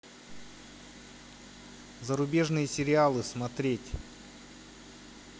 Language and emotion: Russian, neutral